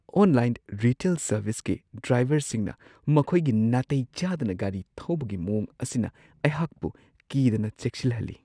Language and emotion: Manipuri, fearful